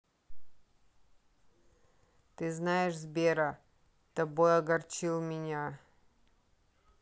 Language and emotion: Russian, sad